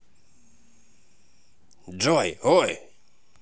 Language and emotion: Russian, positive